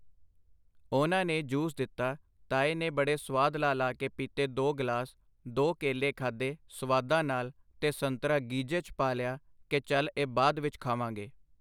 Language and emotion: Punjabi, neutral